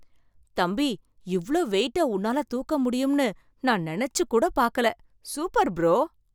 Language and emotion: Tamil, surprised